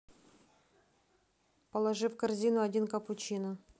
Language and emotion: Russian, neutral